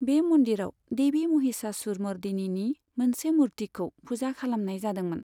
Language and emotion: Bodo, neutral